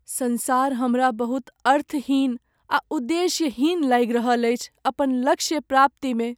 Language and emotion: Maithili, sad